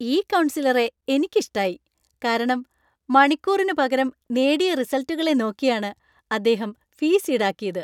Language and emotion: Malayalam, happy